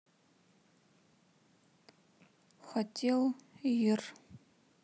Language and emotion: Russian, sad